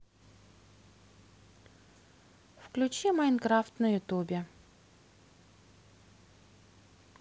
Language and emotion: Russian, neutral